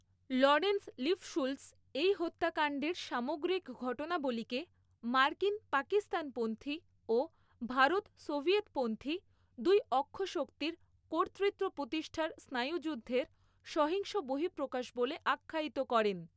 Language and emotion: Bengali, neutral